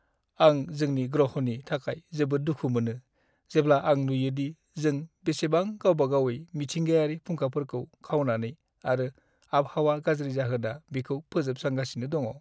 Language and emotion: Bodo, sad